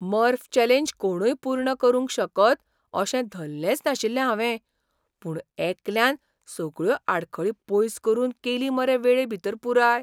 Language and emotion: Goan Konkani, surprised